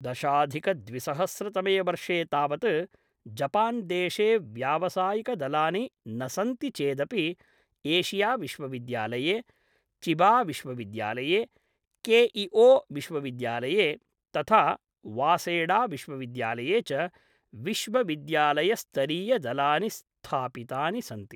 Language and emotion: Sanskrit, neutral